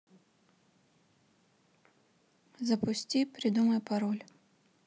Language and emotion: Russian, neutral